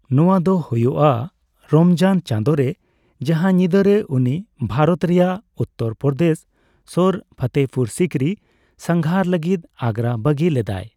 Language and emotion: Santali, neutral